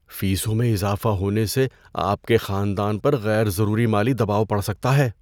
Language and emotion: Urdu, fearful